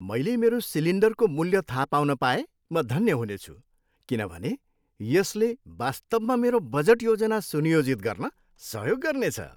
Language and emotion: Nepali, happy